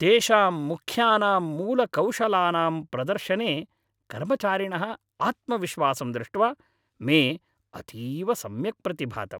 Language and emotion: Sanskrit, happy